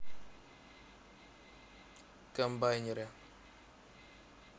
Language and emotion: Russian, neutral